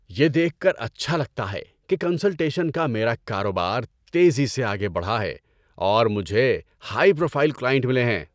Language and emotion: Urdu, happy